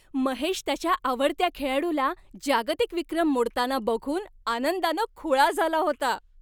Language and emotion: Marathi, happy